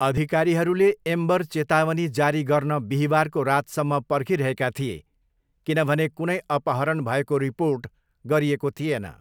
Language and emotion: Nepali, neutral